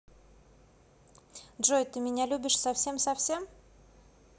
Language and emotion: Russian, positive